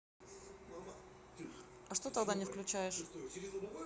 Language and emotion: Russian, neutral